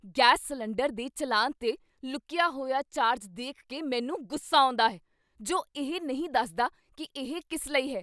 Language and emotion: Punjabi, angry